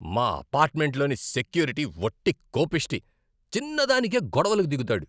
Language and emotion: Telugu, angry